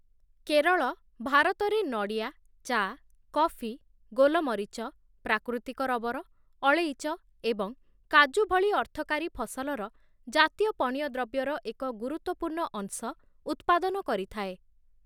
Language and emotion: Odia, neutral